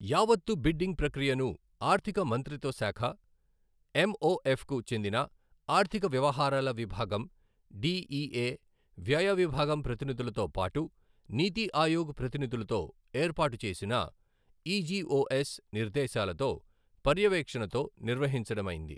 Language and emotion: Telugu, neutral